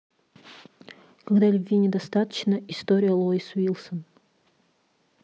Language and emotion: Russian, neutral